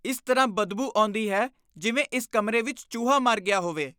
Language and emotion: Punjabi, disgusted